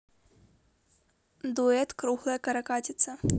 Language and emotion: Russian, neutral